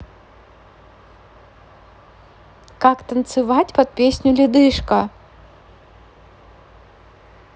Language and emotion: Russian, neutral